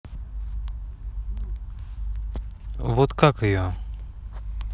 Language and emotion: Russian, neutral